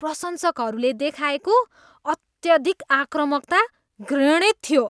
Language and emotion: Nepali, disgusted